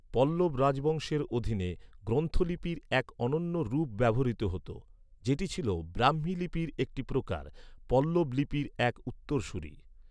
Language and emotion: Bengali, neutral